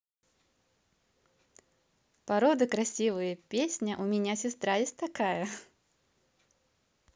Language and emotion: Russian, positive